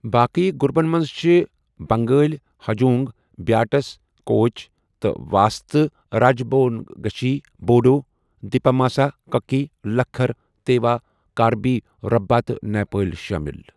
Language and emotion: Kashmiri, neutral